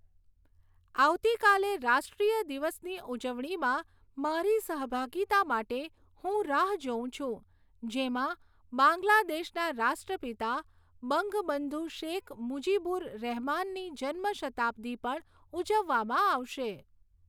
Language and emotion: Gujarati, neutral